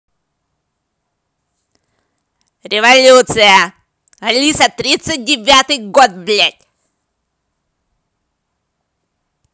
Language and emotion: Russian, angry